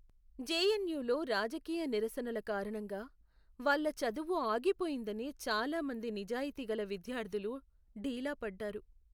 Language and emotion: Telugu, sad